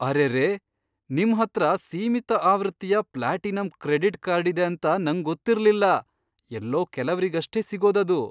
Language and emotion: Kannada, surprised